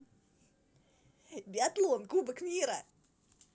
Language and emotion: Russian, positive